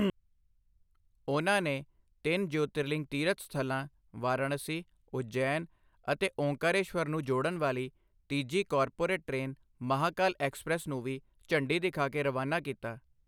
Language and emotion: Punjabi, neutral